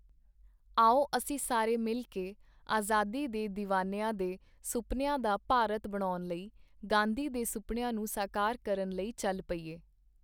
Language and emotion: Punjabi, neutral